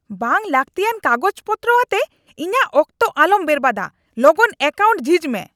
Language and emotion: Santali, angry